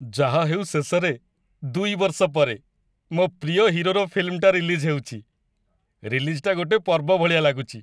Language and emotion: Odia, happy